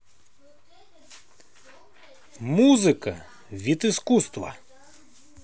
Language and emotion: Russian, positive